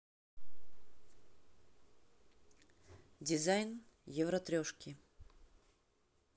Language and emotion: Russian, neutral